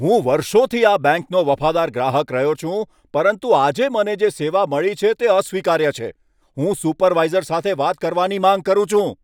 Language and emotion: Gujarati, angry